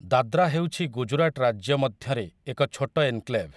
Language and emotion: Odia, neutral